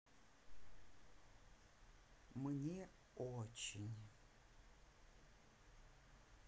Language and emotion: Russian, neutral